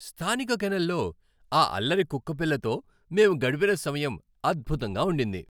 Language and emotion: Telugu, happy